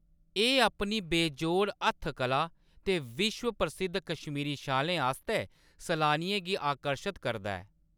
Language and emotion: Dogri, neutral